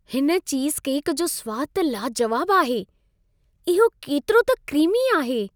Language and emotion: Sindhi, happy